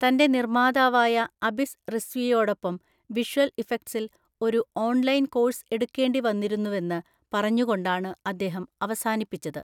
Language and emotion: Malayalam, neutral